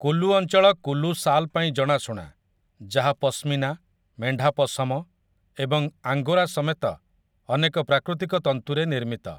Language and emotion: Odia, neutral